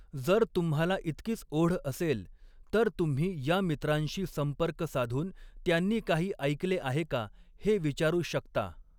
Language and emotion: Marathi, neutral